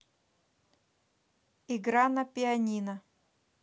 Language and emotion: Russian, neutral